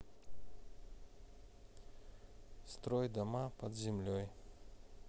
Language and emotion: Russian, neutral